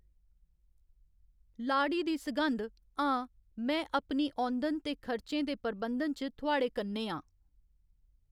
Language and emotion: Dogri, neutral